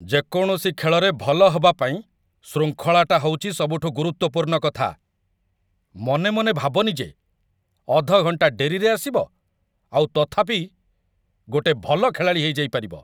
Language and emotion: Odia, angry